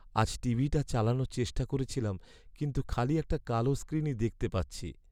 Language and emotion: Bengali, sad